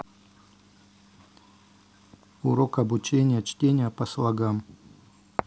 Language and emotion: Russian, neutral